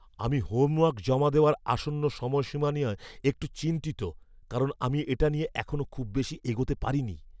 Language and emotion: Bengali, fearful